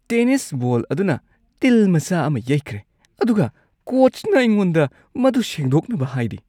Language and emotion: Manipuri, disgusted